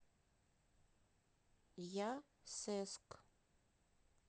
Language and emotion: Russian, neutral